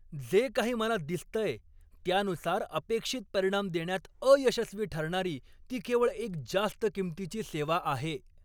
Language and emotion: Marathi, angry